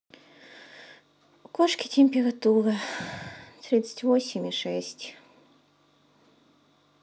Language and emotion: Russian, sad